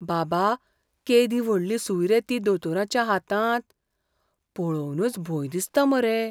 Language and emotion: Goan Konkani, fearful